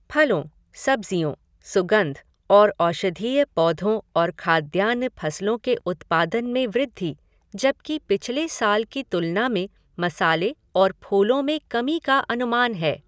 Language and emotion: Hindi, neutral